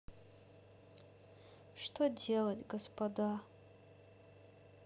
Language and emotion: Russian, sad